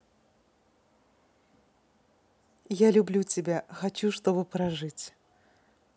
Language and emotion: Russian, positive